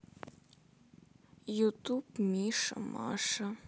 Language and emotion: Russian, sad